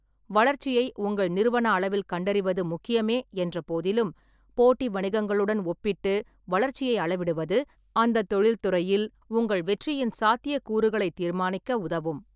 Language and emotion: Tamil, neutral